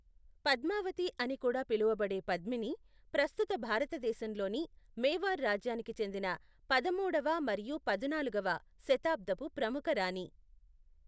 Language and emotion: Telugu, neutral